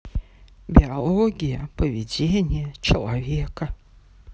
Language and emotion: Russian, neutral